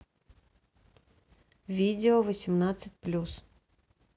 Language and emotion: Russian, neutral